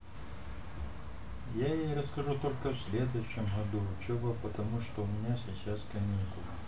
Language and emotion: Russian, neutral